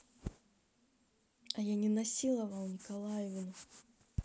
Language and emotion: Russian, neutral